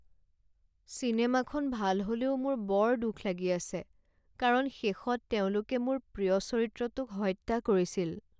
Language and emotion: Assamese, sad